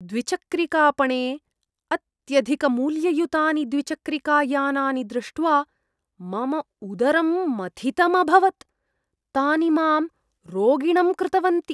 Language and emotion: Sanskrit, disgusted